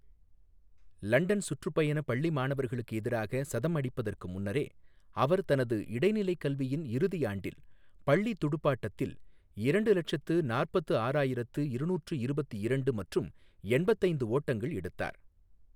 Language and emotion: Tamil, neutral